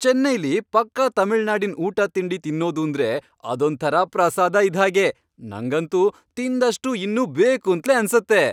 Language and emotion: Kannada, happy